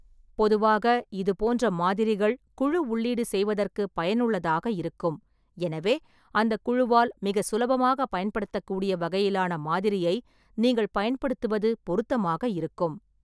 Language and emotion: Tamil, neutral